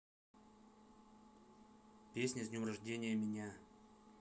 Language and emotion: Russian, neutral